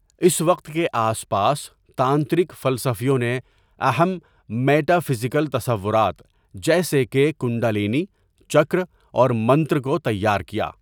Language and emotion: Urdu, neutral